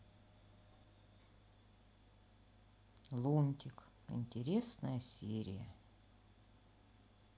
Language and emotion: Russian, sad